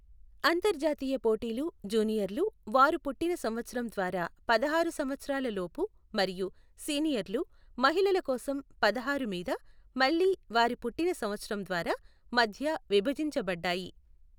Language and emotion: Telugu, neutral